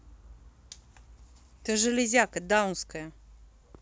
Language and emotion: Russian, angry